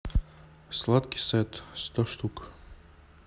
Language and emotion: Russian, neutral